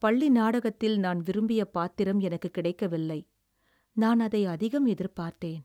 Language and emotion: Tamil, sad